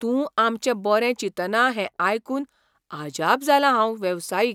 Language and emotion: Goan Konkani, surprised